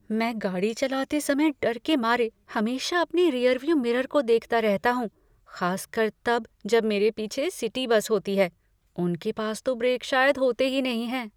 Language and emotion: Hindi, fearful